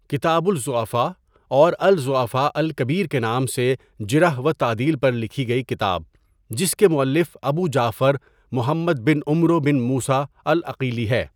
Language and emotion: Urdu, neutral